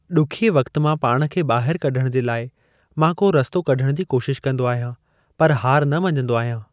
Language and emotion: Sindhi, neutral